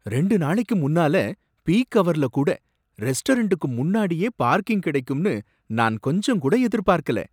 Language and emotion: Tamil, surprised